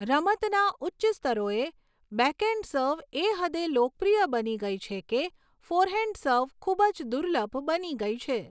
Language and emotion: Gujarati, neutral